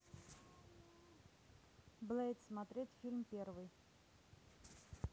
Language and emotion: Russian, neutral